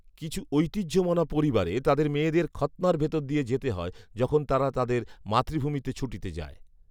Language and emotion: Bengali, neutral